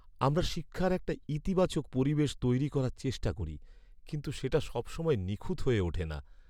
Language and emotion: Bengali, sad